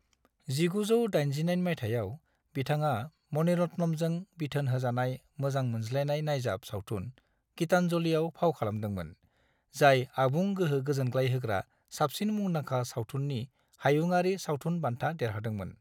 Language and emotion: Bodo, neutral